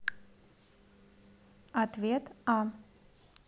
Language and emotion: Russian, neutral